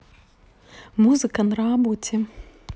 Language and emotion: Russian, neutral